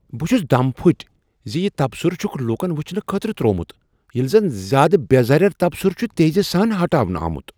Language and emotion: Kashmiri, surprised